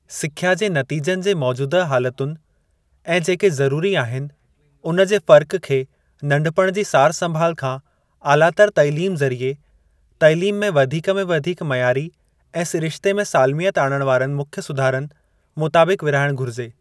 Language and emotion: Sindhi, neutral